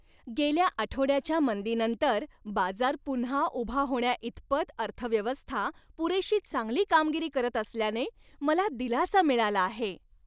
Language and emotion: Marathi, happy